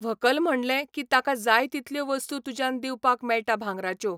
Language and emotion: Goan Konkani, neutral